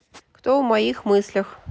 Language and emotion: Russian, neutral